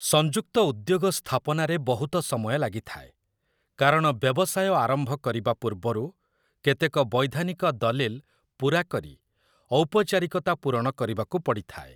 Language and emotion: Odia, neutral